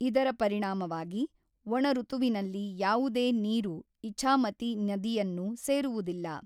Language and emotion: Kannada, neutral